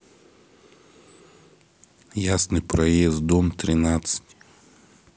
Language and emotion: Russian, neutral